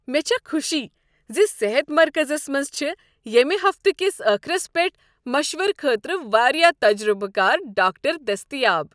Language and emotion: Kashmiri, happy